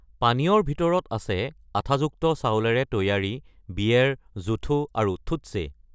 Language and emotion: Assamese, neutral